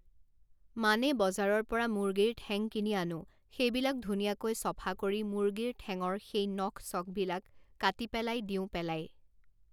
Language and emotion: Assamese, neutral